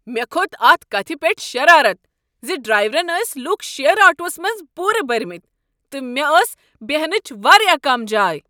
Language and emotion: Kashmiri, angry